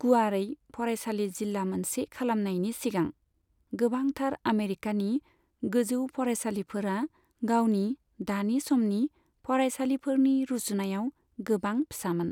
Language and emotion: Bodo, neutral